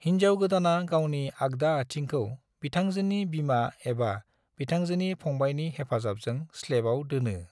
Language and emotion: Bodo, neutral